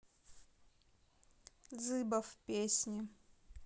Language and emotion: Russian, neutral